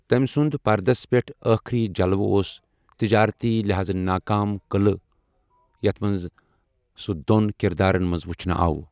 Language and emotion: Kashmiri, neutral